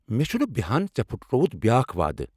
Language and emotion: Kashmiri, angry